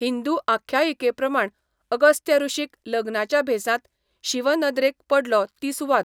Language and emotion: Goan Konkani, neutral